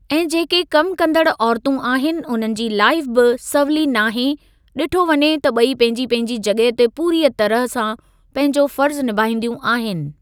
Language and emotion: Sindhi, neutral